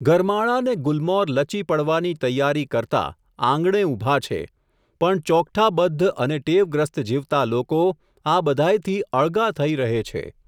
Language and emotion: Gujarati, neutral